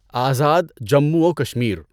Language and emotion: Urdu, neutral